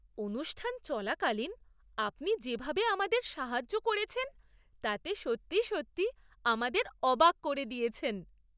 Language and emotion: Bengali, surprised